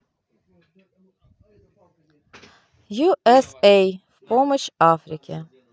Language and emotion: Russian, neutral